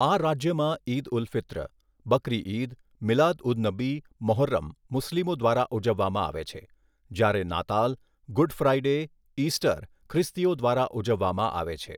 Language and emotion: Gujarati, neutral